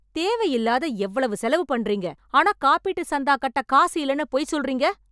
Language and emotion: Tamil, angry